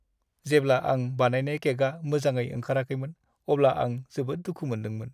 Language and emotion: Bodo, sad